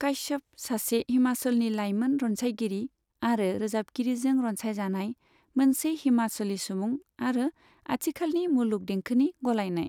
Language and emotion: Bodo, neutral